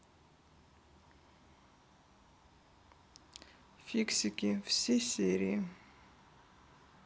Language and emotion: Russian, sad